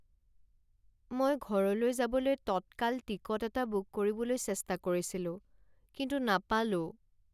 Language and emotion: Assamese, sad